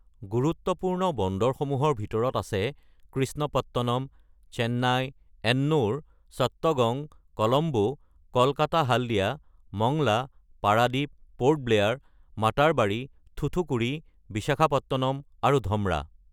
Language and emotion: Assamese, neutral